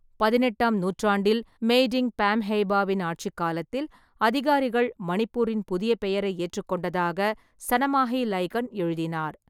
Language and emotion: Tamil, neutral